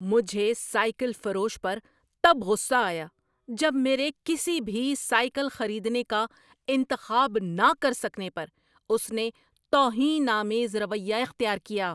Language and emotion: Urdu, angry